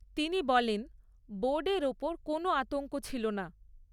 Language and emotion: Bengali, neutral